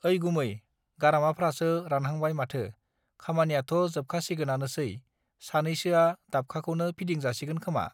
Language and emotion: Bodo, neutral